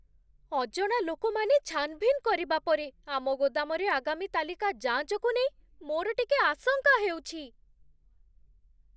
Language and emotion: Odia, fearful